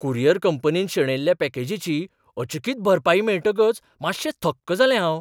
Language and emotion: Goan Konkani, surprised